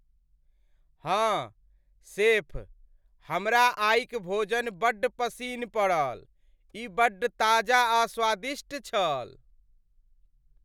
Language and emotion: Maithili, happy